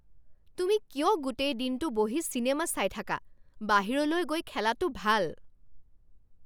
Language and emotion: Assamese, angry